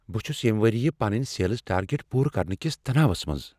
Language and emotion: Kashmiri, fearful